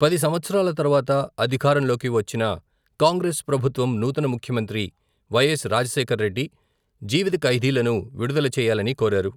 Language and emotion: Telugu, neutral